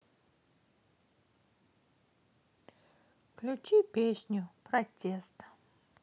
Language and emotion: Russian, sad